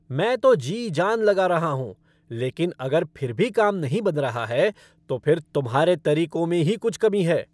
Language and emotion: Hindi, angry